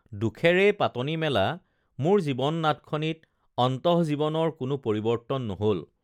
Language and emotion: Assamese, neutral